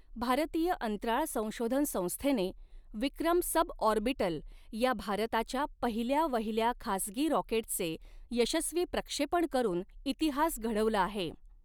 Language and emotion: Marathi, neutral